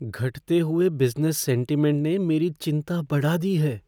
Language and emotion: Hindi, fearful